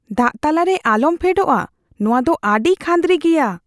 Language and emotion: Santali, fearful